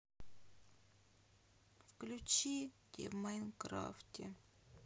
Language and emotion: Russian, sad